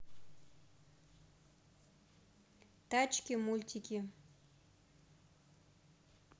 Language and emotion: Russian, neutral